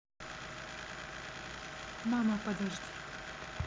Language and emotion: Russian, neutral